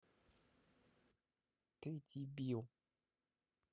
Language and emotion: Russian, angry